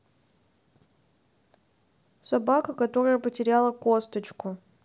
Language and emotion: Russian, sad